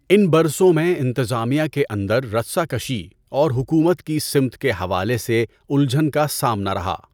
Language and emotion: Urdu, neutral